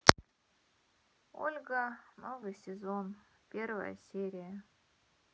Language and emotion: Russian, sad